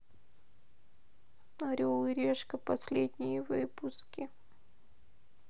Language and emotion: Russian, sad